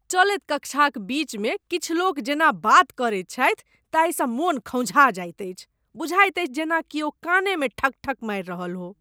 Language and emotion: Maithili, disgusted